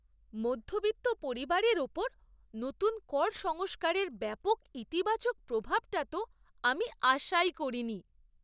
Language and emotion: Bengali, surprised